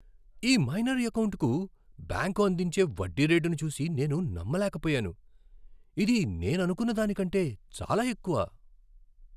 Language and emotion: Telugu, surprised